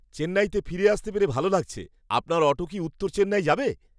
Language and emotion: Bengali, happy